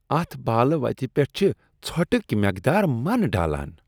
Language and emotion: Kashmiri, disgusted